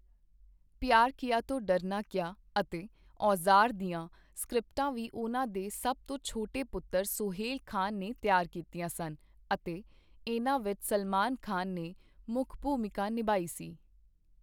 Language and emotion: Punjabi, neutral